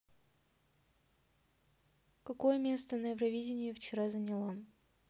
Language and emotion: Russian, neutral